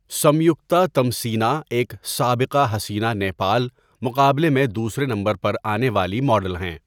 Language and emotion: Urdu, neutral